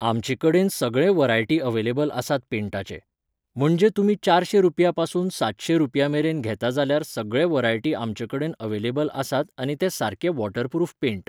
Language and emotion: Goan Konkani, neutral